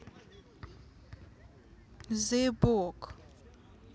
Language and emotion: Russian, neutral